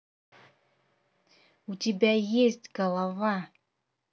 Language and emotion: Russian, angry